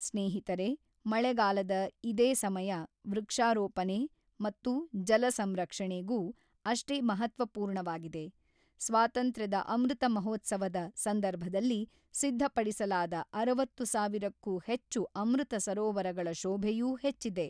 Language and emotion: Kannada, neutral